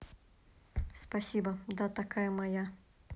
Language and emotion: Russian, neutral